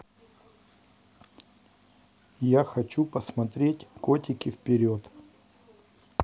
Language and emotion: Russian, neutral